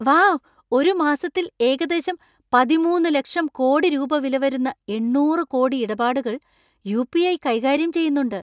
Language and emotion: Malayalam, surprised